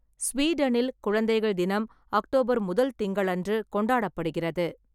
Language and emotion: Tamil, neutral